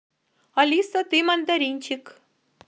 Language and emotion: Russian, positive